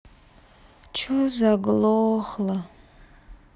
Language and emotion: Russian, sad